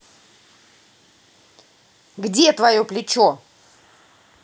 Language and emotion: Russian, angry